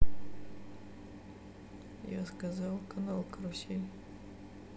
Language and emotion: Russian, sad